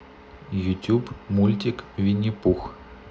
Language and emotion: Russian, neutral